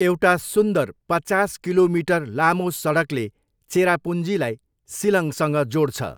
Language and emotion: Nepali, neutral